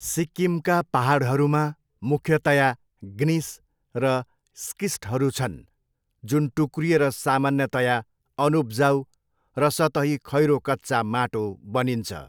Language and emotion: Nepali, neutral